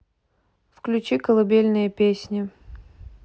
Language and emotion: Russian, neutral